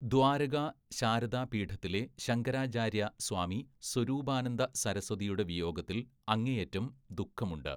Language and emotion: Malayalam, neutral